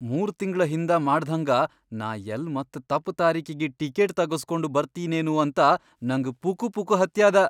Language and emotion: Kannada, fearful